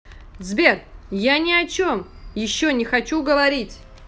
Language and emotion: Russian, angry